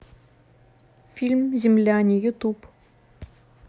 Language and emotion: Russian, neutral